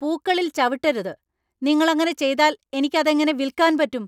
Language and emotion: Malayalam, angry